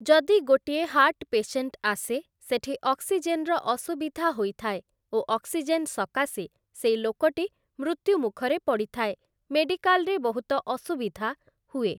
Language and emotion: Odia, neutral